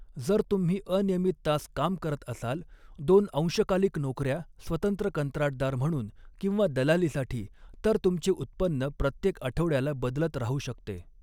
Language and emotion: Marathi, neutral